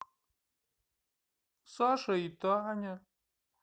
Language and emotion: Russian, sad